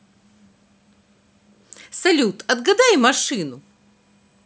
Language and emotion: Russian, positive